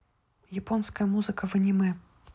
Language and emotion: Russian, neutral